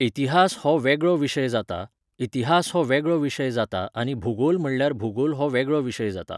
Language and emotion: Goan Konkani, neutral